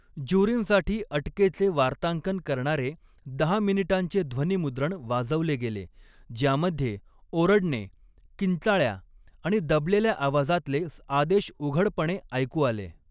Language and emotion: Marathi, neutral